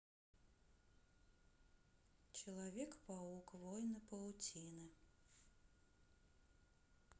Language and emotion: Russian, sad